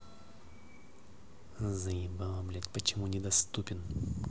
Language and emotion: Russian, angry